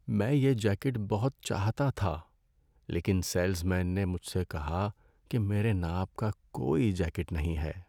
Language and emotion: Urdu, sad